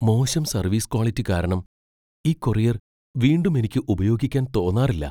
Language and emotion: Malayalam, fearful